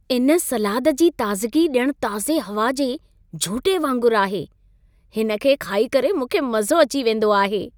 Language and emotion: Sindhi, happy